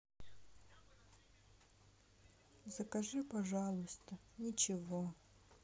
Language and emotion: Russian, sad